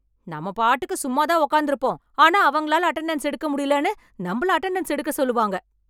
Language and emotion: Tamil, angry